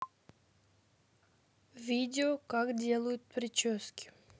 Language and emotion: Russian, neutral